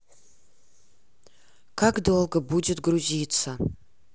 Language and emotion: Russian, neutral